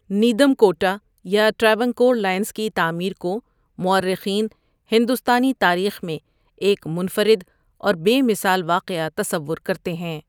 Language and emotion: Urdu, neutral